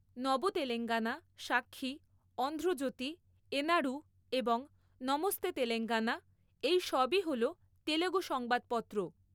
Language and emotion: Bengali, neutral